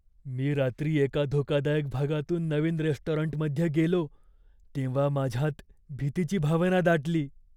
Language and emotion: Marathi, fearful